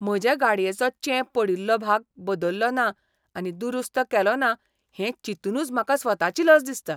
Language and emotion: Goan Konkani, disgusted